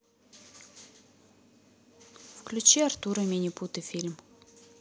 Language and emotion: Russian, neutral